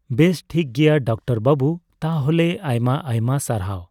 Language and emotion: Santali, neutral